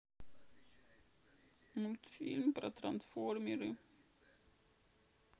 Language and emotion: Russian, sad